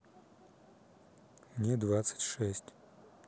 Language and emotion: Russian, neutral